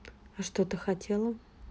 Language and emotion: Russian, neutral